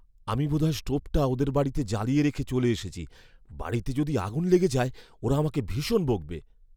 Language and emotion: Bengali, fearful